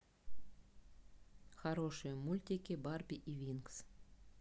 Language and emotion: Russian, neutral